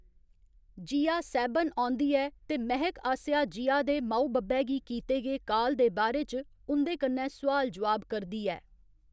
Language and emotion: Dogri, neutral